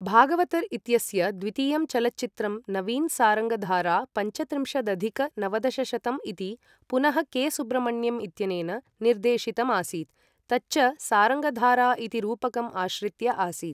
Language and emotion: Sanskrit, neutral